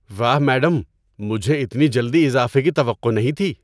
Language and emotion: Urdu, surprised